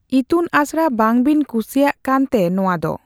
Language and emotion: Santali, neutral